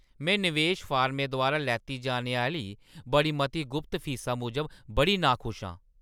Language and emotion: Dogri, angry